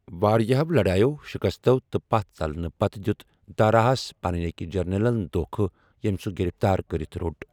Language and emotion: Kashmiri, neutral